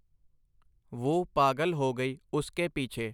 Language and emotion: Punjabi, neutral